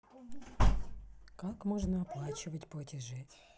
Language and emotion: Russian, neutral